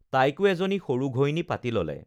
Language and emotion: Assamese, neutral